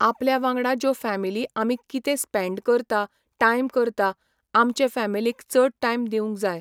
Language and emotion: Goan Konkani, neutral